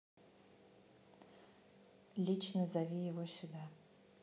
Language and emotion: Russian, neutral